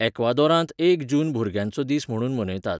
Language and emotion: Goan Konkani, neutral